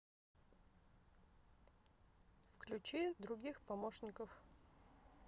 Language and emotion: Russian, neutral